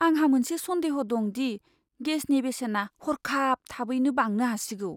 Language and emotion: Bodo, fearful